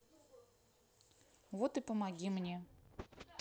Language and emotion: Russian, neutral